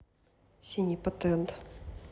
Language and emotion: Russian, neutral